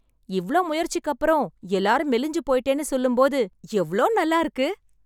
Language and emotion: Tamil, happy